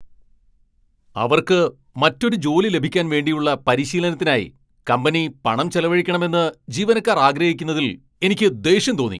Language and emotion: Malayalam, angry